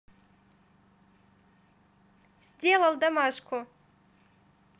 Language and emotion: Russian, positive